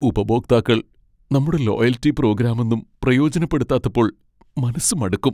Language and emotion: Malayalam, sad